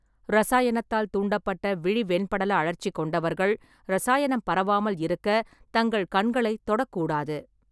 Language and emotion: Tamil, neutral